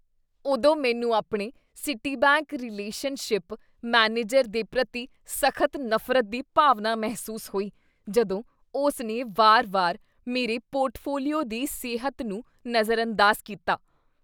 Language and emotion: Punjabi, disgusted